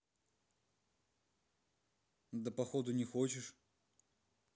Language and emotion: Russian, neutral